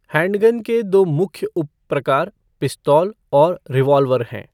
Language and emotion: Hindi, neutral